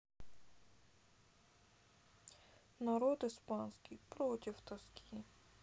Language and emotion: Russian, sad